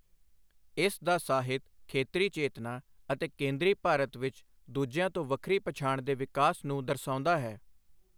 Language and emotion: Punjabi, neutral